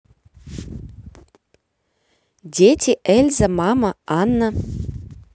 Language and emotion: Russian, positive